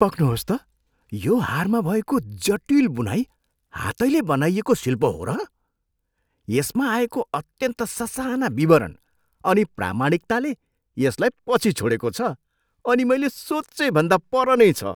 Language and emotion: Nepali, surprised